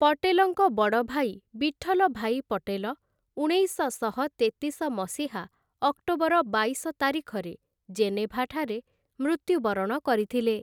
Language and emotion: Odia, neutral